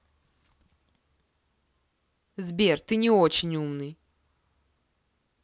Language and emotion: Russian, angry